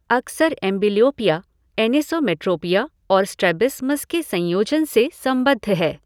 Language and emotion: Hindi, neutral